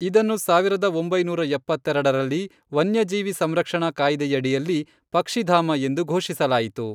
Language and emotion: Kannada, neutral